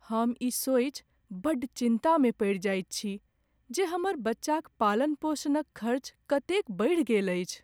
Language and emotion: Maithili, sad